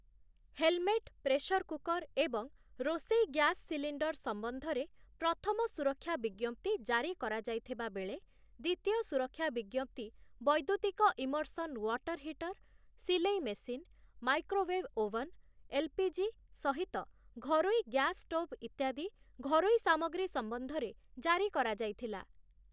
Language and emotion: Odia, neutral